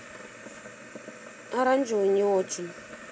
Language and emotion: Russian, neutral